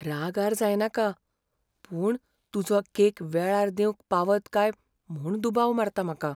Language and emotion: Goan Konkani, fearful